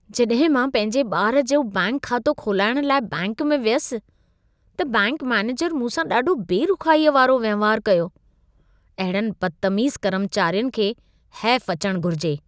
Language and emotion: Sindhi, disgusted